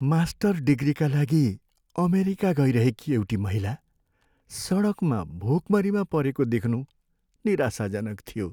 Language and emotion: Nepali, sad